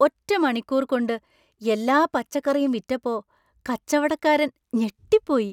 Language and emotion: Malayalam, surprised